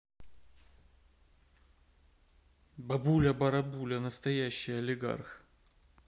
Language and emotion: Russian, neutral